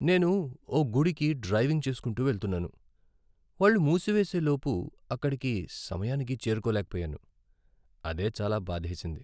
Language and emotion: Telugu, sad